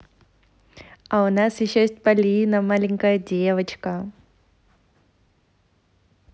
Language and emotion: Russian, positive